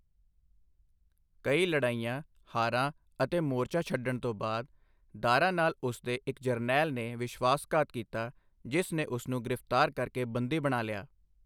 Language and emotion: Punjabi, neutral